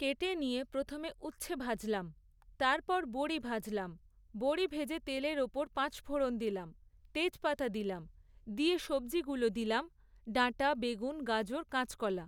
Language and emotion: Bengali, neutral